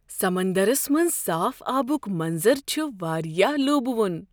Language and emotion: Kashmiri, surprised